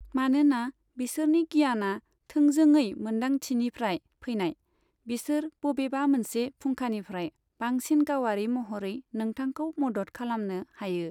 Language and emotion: Bodo, neutral